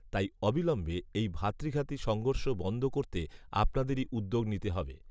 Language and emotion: Bengali, neutral